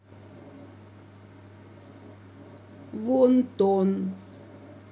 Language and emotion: Russian, neutral